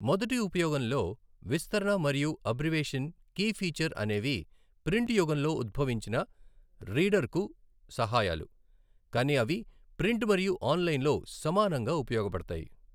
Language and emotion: Telugu, neutral